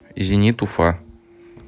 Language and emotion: Russian, neutral